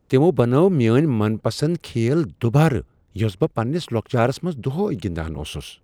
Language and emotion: Kashmiri, surprised